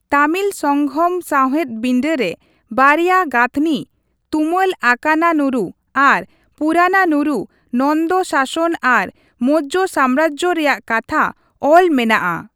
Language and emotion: Santali, neutral